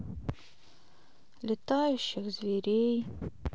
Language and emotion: Russian, sad